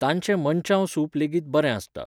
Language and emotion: Goan Konkani, neutral